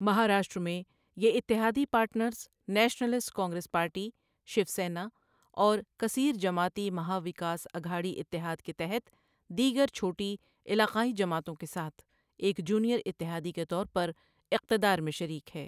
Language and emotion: Urdu, neutral